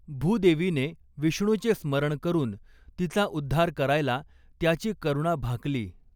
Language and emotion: Marathi, neutral